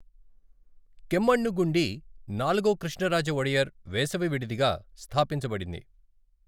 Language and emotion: Telugu, neutral